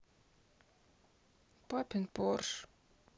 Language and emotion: Russian, sad